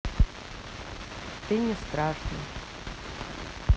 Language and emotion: Russian, neutral